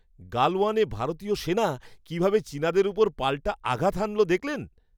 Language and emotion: Bengali, happy